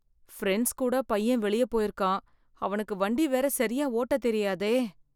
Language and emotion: Tamil, fearful